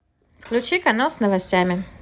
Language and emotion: Russian, neutral